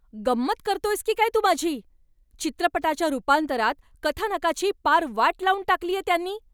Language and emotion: Marathi, angry